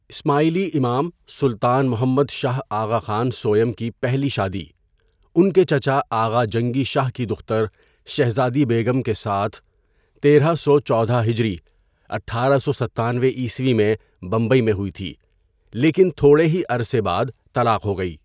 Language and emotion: Urdu, neutral